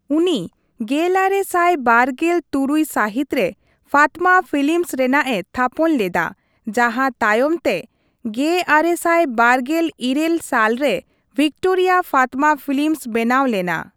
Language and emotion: Santali, neutral